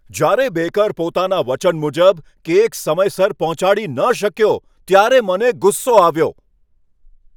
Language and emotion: Gujarati, angry